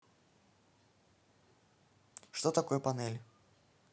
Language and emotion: Russian, neutral